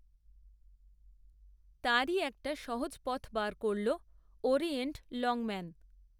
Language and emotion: Bengali, neutral